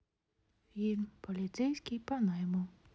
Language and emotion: Russian, neutral